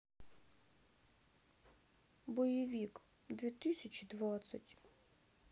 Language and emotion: Russian, sad